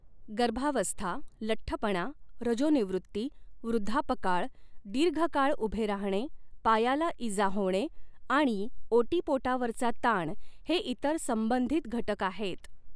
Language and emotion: Marathi, neutral